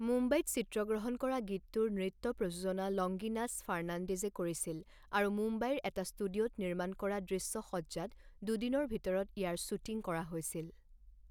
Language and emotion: Assamese, neutral